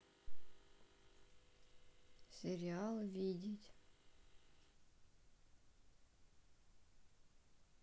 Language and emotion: Russian, neutral